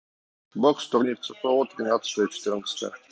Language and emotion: Russian, neutral